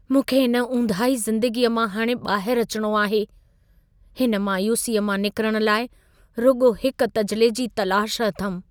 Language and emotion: Sindhi, sad